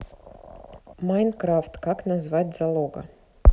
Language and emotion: Russian, neutral